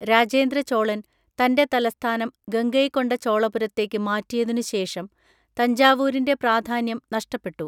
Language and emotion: Malayalam, neutral